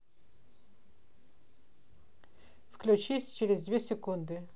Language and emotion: Russian, neutral